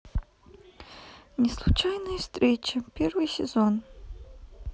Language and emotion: Russian, neutral